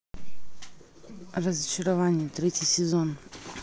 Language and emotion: Russian, neutral